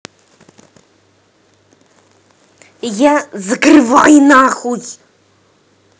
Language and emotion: Russian, angry